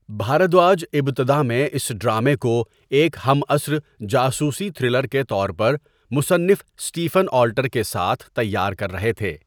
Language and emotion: Urdu, neutral